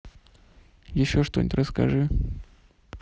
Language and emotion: Russian, neutral